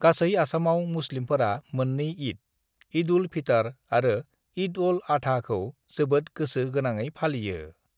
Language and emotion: Bodo, neutral